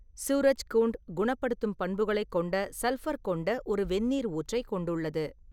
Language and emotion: Tamil, neutral